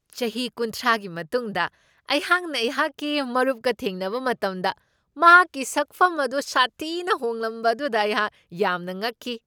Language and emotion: Manipuri, surprised